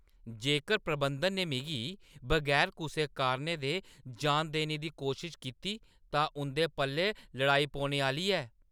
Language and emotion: Dogri, angry